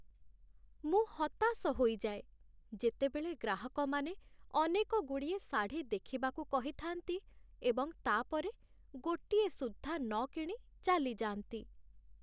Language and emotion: Odia, sad